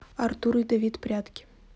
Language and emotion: Russian, neutral